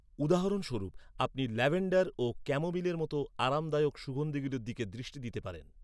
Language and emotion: Bengali, neutral